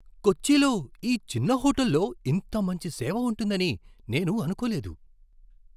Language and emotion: Telugu, surprised